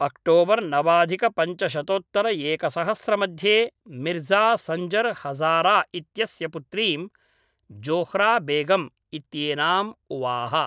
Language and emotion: Sanskrit, neutral